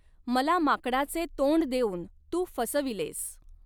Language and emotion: Marathi, neutral